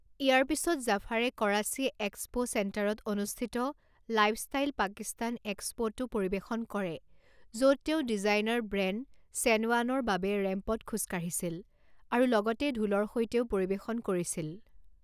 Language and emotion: Assamese, neutral